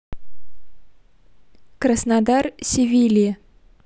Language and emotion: Russian, neutral